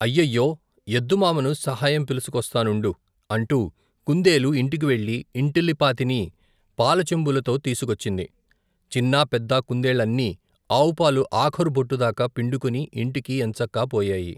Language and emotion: Telugu, neutral